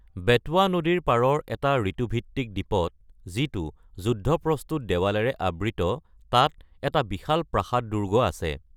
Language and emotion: Assamese, neutral